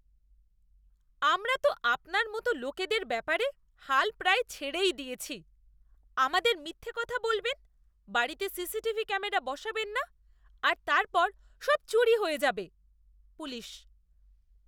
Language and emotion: Bengali, disgusted